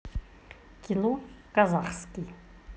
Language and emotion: Russian, neutral